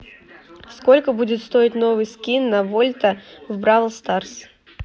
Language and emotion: Russian, neutral